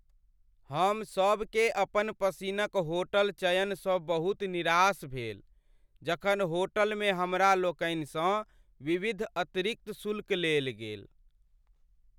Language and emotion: Maithili, sad